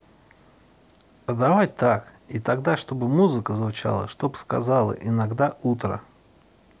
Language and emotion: Russian, neutral